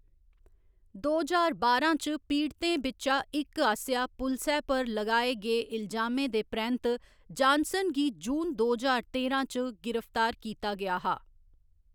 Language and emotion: Dogri, neutral